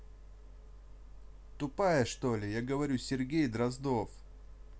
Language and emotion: Russian, neutral